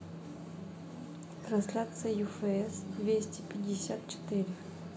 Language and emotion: Russian, neutral